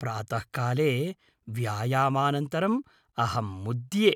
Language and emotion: Sanskrit, happy